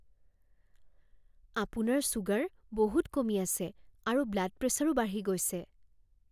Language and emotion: Assamese, fearful